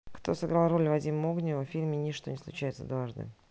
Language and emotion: Russian, neutral